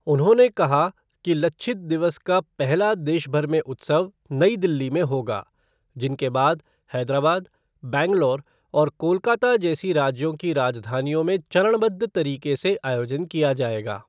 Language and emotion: Hindi, neutral